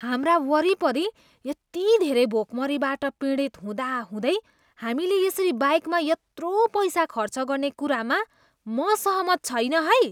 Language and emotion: Nepali, disgusted